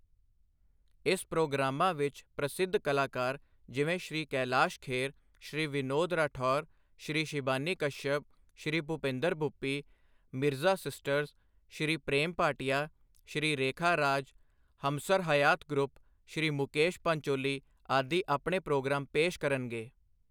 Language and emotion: Punjabi, neutral